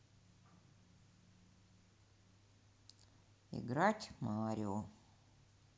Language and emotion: Russian, neutral